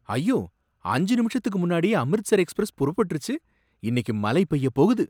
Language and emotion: Tamil, surprised